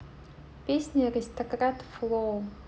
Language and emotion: Russian, neutral